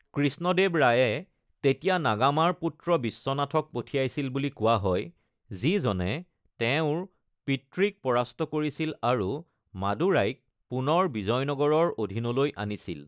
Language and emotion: Assamese, neutral